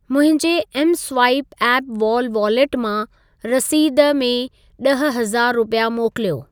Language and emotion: Sindhi, neutral